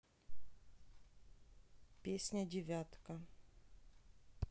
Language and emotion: Russian, neutral